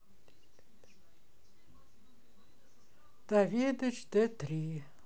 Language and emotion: Russian, sad